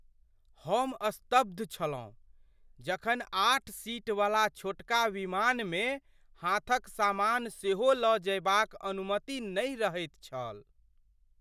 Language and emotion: Maithili, surprised